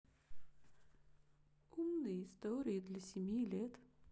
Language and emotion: Russian, sad